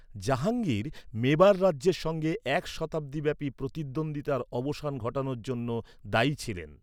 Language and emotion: Bengali, neutral